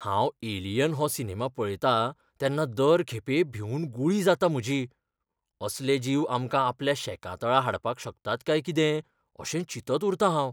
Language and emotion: Goan Konkani, fearful